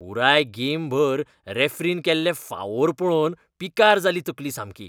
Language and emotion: Goan Konkani, disgusted